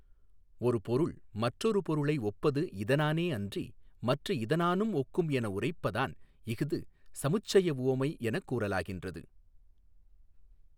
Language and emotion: Tamil, neutral